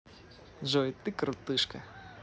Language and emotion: Russian, positive